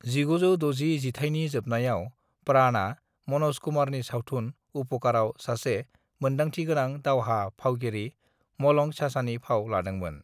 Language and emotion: Bodo, neutral